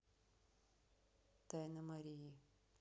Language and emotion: Russian, neutral